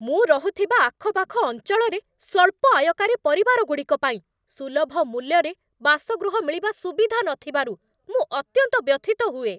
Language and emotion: Odia, angry